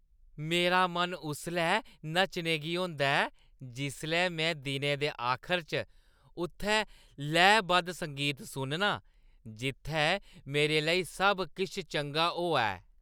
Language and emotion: Dogri, happy